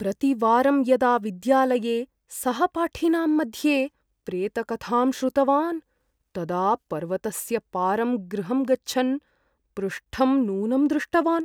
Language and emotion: Sanskrit, fearful